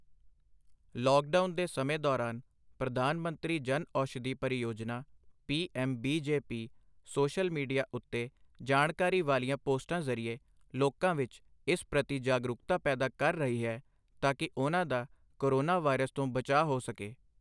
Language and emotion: Punjabi, neutral